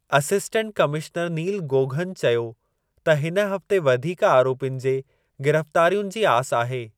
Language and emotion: Sindhi, neutral